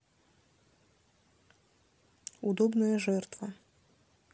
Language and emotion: Russian, neutral